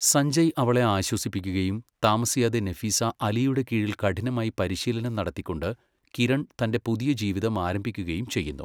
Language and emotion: Malayalam, neutral